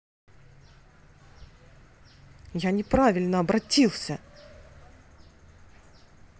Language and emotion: Russian, angry